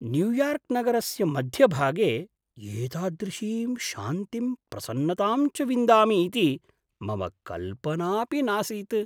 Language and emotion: Sanskrit, surprised